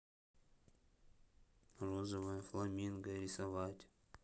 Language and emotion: Russian, sad